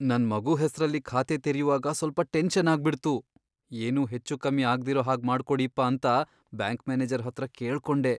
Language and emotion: Kannada, fearful